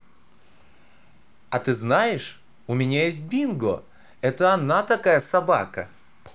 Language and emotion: Russian, positive